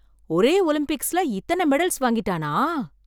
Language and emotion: Tamil, surprised